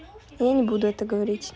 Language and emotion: Russian, neutral